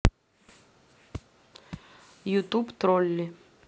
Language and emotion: Russian, neutral